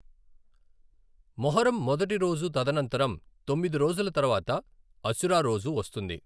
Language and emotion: Telugu, neutral